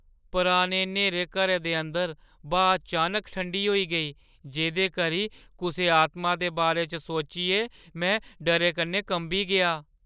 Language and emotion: Dogri, fearful